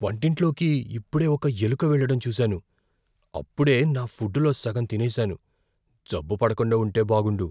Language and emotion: Telugu, fearful